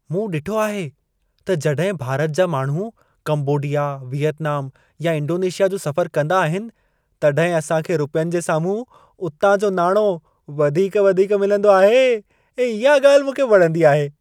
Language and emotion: Sindhi, happy